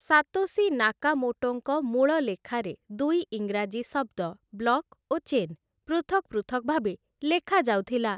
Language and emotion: Odia, neutral